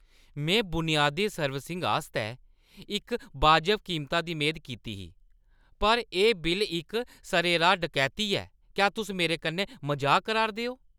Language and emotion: Dogri, angry